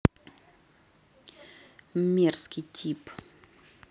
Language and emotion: Russian, angry